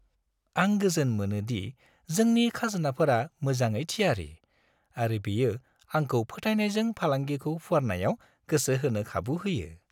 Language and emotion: Bodo, happy